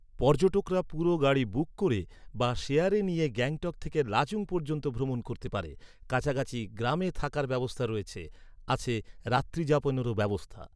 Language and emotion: Bengali, neutral